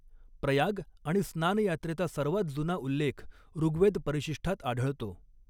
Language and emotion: Marathi, neutral